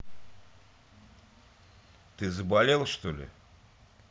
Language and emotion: Russian, neutral